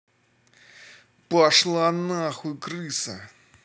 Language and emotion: Russian, angry